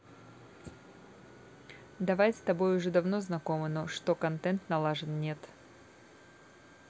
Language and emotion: Russian, neutral